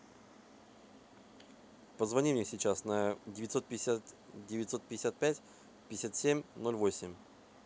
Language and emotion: Russian, neutral